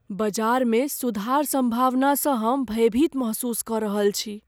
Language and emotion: Maithili, fearful